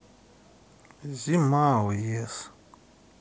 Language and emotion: Russian, sad